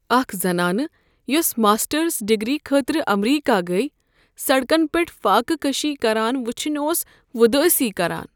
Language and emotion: Kashmiri, sad